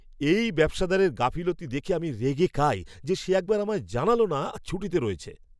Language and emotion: Bengali, angry